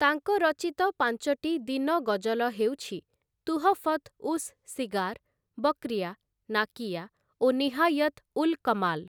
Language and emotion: Odia, neutral